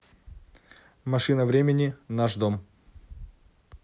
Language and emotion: Russian, neutral